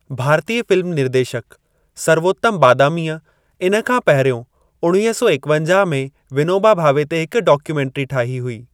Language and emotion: Sindhi, neutral